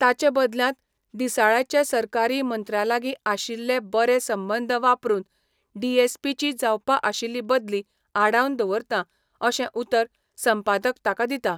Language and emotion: Goan Konkani, neutral